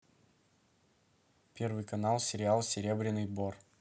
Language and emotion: Russian, neutral